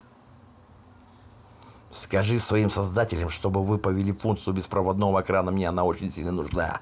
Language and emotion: Russian, angry